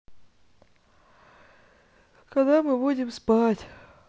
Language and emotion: Russian, neutral